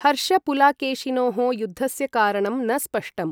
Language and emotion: Sanskrit, neutral